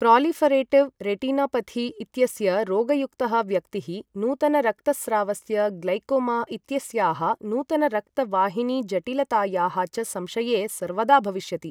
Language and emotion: Sanskrit, neutral